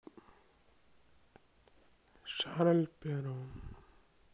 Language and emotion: Russian, sad